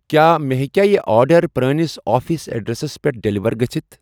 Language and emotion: Kashmiri, neutral